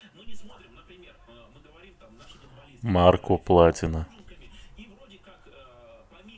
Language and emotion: Russian, neutral